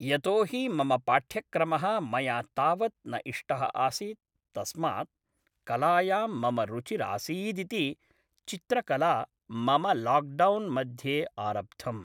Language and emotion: Sanskrit, neutral